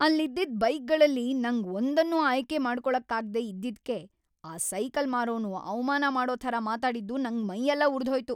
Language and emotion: Kannada, angry